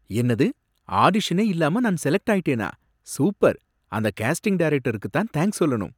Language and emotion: Tamil, surprised